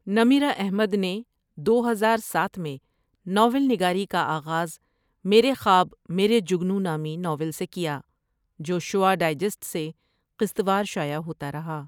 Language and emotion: Urdu, neutral